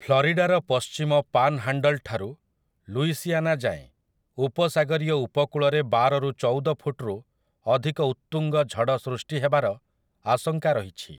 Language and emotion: Odia, neutral